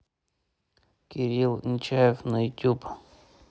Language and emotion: Russian, neutral